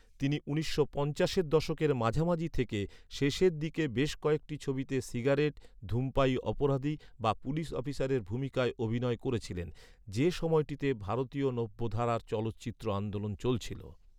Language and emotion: Bengali, neutral